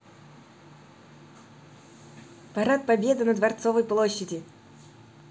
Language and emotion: Russian, positive